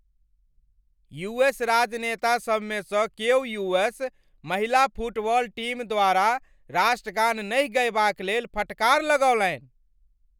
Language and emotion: Maithili, angry